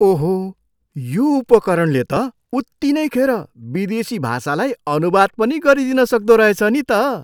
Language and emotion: Nepali, surprised